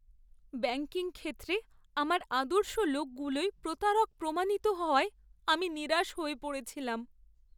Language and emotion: Bengali, sad